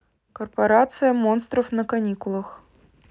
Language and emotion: Russian, neutral